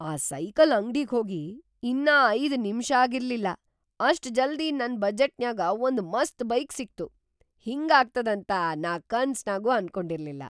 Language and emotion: Kannada, surprised